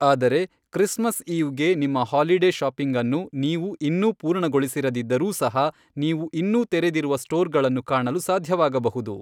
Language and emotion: Kannada, neutral